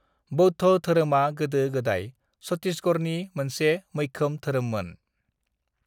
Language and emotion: Bodo, neutral